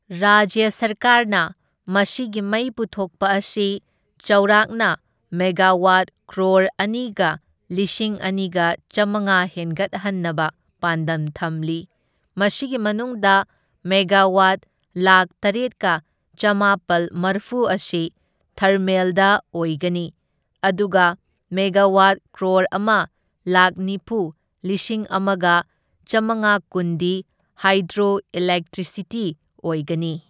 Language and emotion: Manipuri, neutral